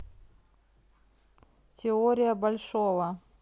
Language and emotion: Russian, neutral